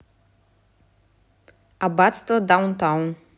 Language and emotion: Russian, neutral